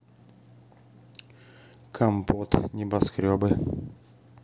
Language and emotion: Russian, neutral